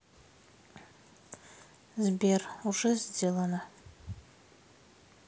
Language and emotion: Russian, sad